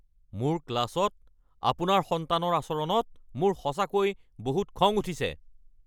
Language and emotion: Assamese, angry